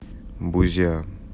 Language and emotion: Russian, neutral